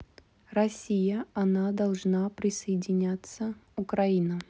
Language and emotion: Russian, neutral